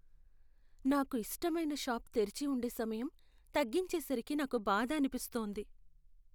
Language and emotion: Telugu, sad